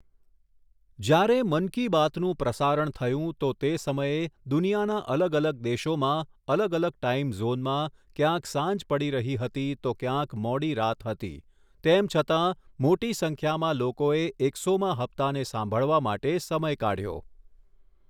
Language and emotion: Gujarati, neutral